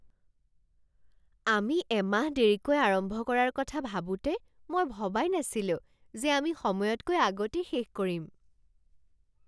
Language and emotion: Assamese, surprised